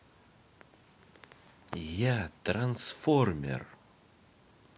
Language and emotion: Russian, positive